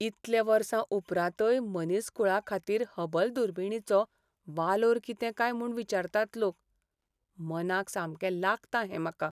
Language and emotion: Goan Konkani, sad